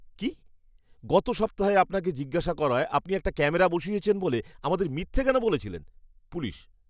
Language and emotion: Bengali, angry